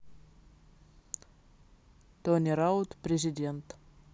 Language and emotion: Russian, neutral